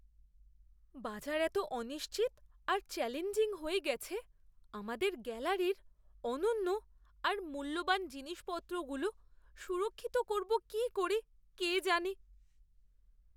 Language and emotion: Bengali, fearful